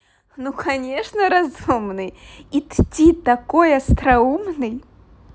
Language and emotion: Russian, positive